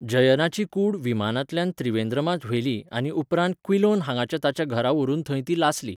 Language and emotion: Goan Konkani, neutral